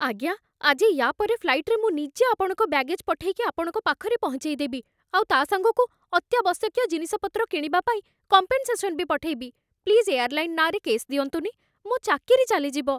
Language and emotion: Odia, fearful